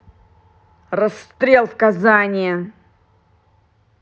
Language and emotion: Russian, angry